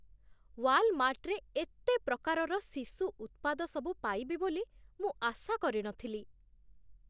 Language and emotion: Odia, surprised